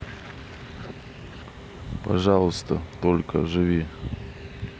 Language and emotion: Russian, neutral